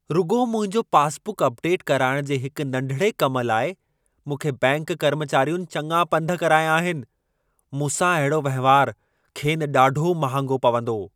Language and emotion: Sindhi, angry